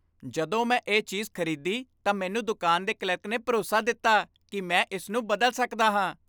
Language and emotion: Punjabi, happy